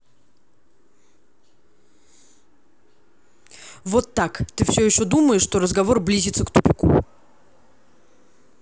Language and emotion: Russian, angry